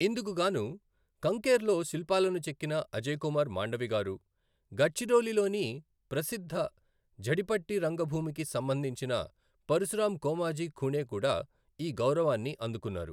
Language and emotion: Telugu, neutral